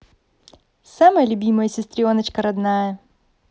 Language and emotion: Russian, positive